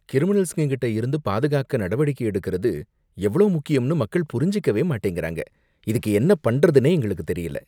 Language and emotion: Tamil, disgusted